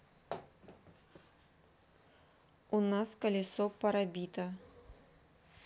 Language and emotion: Russian, neutral